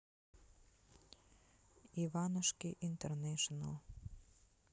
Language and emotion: Russian, neutral